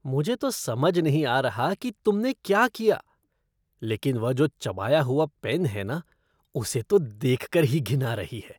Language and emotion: Hindi, disgusted